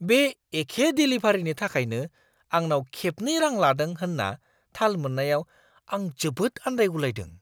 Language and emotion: Bodo, surprised